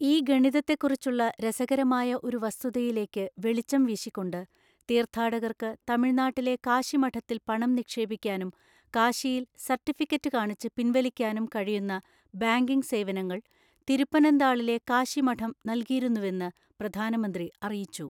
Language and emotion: Malayalam, neutral